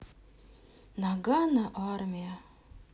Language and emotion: Russian, sad